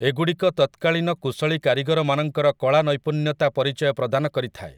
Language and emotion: Odia, neutral